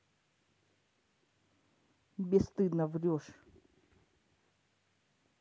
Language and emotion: Russian, angry